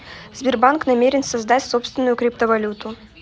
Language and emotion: Russian, neutral